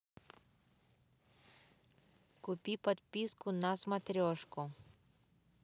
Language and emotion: Russian, neutral